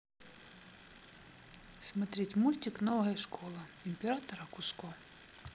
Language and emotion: Russian, neutral